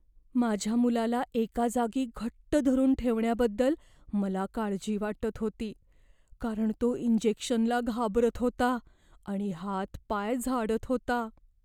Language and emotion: Marathi, fearful